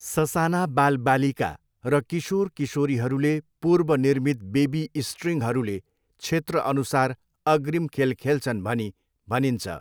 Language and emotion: Nepali, neutral